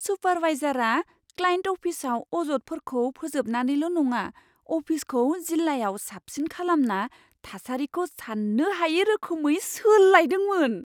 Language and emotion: Bodo, surprised